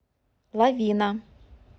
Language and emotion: Russian, neutral